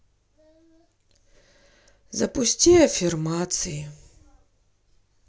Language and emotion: Russian, sad